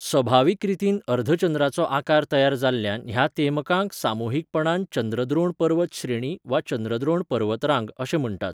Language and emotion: Goan Konkani, neutral